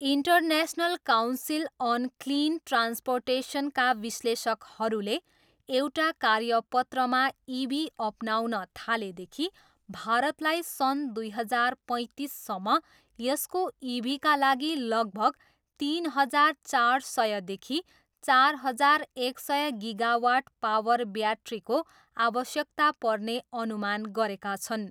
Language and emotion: Nepali, neutral